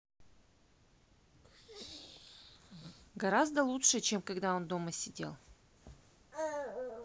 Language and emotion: Russian, neutral